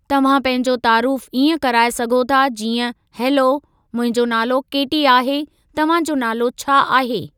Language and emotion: Sindhi, neutral